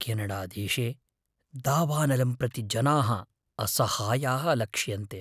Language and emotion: Sanskrit, fearful